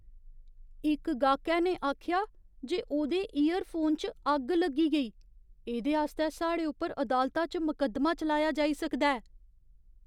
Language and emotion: Dogri, fearful